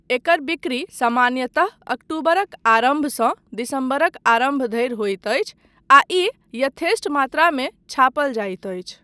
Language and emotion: Maithili, neutral